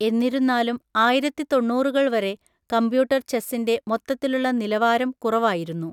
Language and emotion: Malayalam, neutral